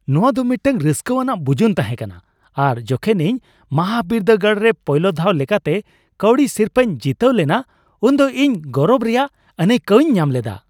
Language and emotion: Santali, happy